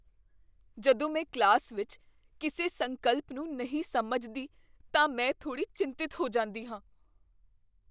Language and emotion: Punjabi, fearful